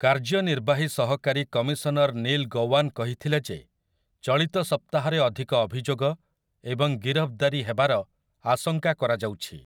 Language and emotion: Odia, neutral